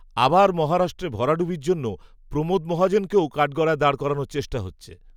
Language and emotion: Bengali, neutral